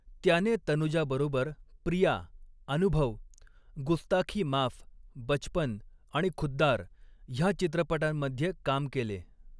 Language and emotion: Marathi, neutral